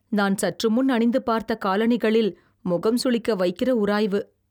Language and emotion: Tamil, disgusted